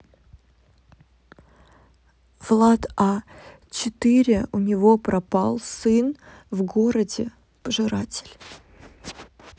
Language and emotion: Russian, neutral